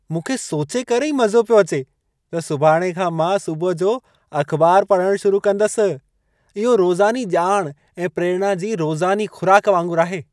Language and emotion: Sindhi, happy